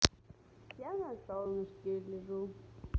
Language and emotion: Russian, positive